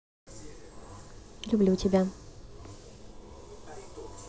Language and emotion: Russian, positive